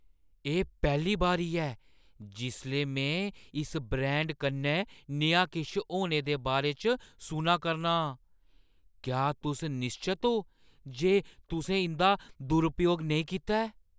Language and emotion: Dogri, surprised